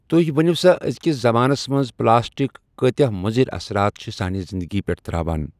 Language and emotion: Kashmiri, neutral